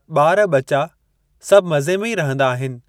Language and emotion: Sindhi, neutral